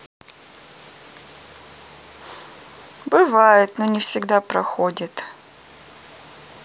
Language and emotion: Russian, sad